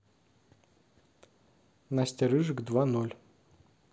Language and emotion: Russian, neutral